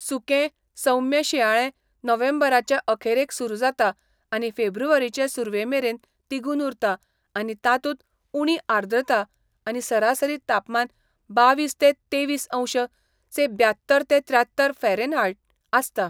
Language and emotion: Goan Konkani, neutral